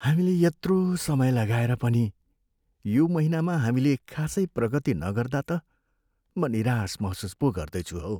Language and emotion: Nepali, sad